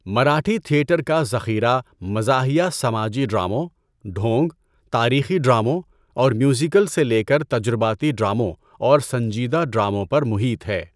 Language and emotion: Urdu, neutral